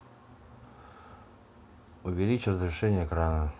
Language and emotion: Russian, neutral